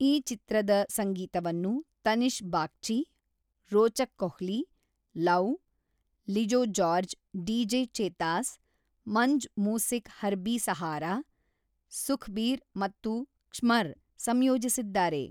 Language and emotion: Kannada, neutral